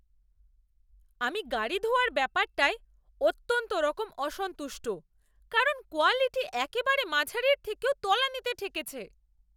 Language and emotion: Bengali, angry